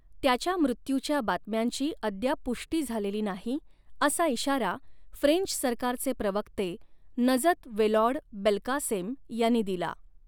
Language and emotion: Marathi, neutral